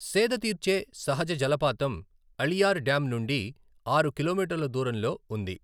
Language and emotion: Telugu, neutral